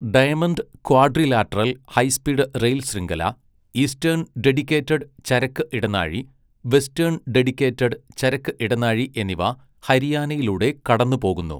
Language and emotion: Malayalam, neutral